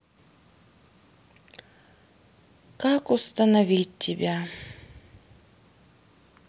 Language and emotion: Russian, sad